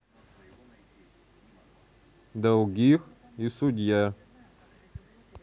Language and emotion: Russian, neutral